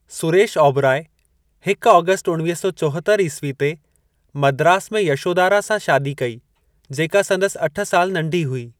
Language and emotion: Sindhi, neutral